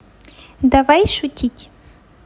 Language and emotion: Russian, positive